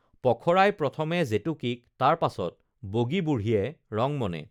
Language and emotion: Assamese, neutral